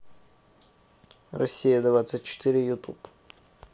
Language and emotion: Russian, neutral